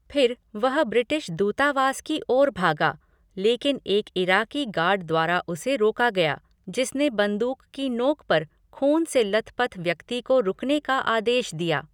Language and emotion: Hindi, neutral